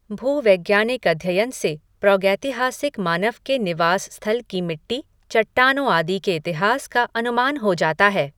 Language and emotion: Hindi, neutral